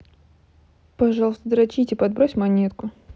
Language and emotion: Russian, neutral